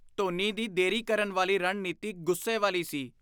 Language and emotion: Punjabi, disgusted